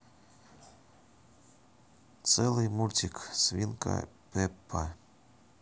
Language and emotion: Russian, neutral